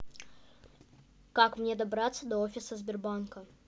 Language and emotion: Russian, neutral